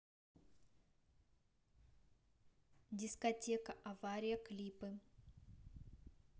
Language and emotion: Russian, neutral